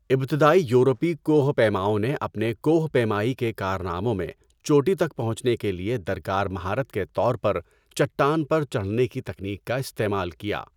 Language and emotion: Urdu, neutral